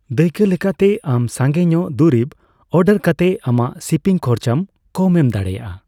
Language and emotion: Santali, neutral